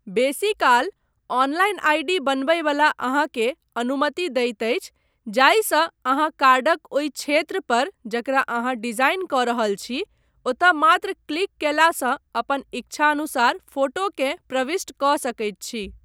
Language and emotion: Maithili, neutral